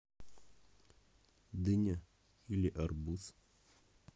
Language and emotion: Russian, neutral